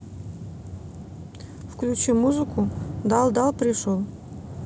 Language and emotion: Russian, neutral